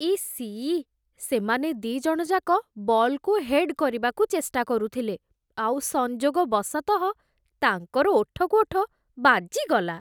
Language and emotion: Odia, disgusted